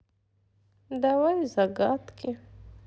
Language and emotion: Russian, sad